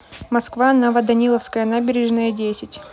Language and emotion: Russian, neutral